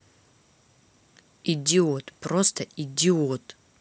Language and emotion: Russian, angry